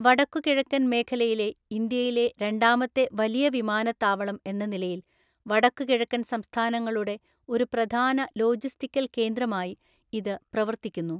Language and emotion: Malayalam, neutral